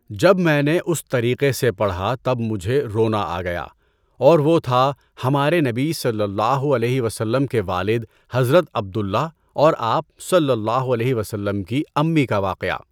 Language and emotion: Urdu, neutral